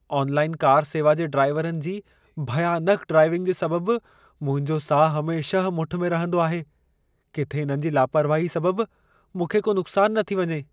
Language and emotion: Sindhi, fearful